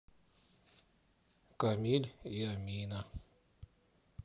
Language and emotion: Russian, sad